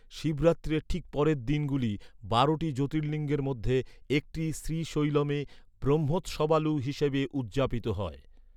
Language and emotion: Bengali, neutral